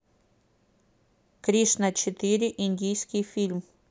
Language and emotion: Russian, neutral